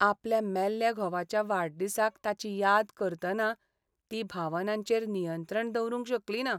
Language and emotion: Goan Konkani, sad